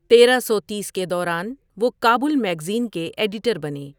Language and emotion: Urdu, neutral